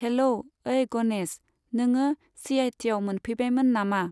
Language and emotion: Bodo, neutral